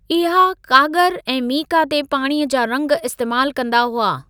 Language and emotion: Sindhi, neutral